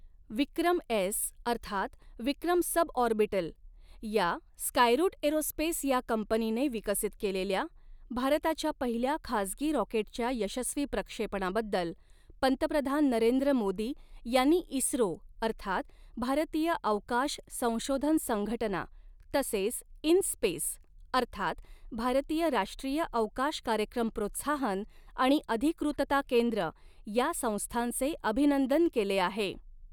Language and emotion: Marathi, neutral